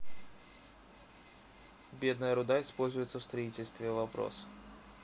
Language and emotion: Russian, neutral